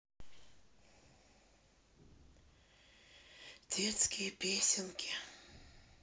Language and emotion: Russian, sad